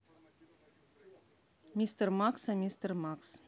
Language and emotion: Russian, neutral